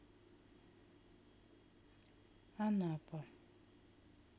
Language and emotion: Russian, neutral